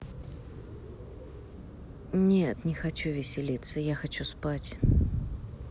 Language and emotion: Russian, sad